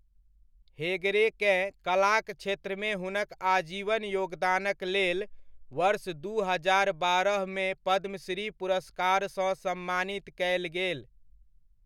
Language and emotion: Maithili, neutral